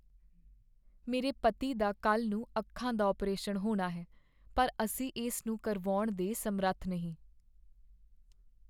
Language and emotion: Punjabi, sad